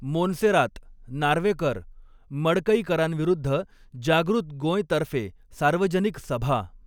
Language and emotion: Marathi, neutral